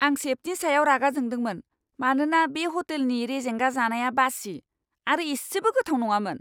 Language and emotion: Bodo, angry